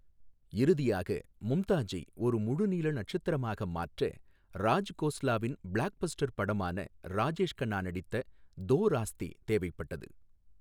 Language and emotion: Tamil, neutral